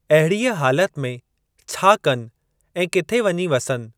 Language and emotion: Sindhi, neutral